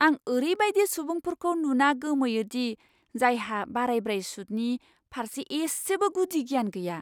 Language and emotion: Bodo, surprised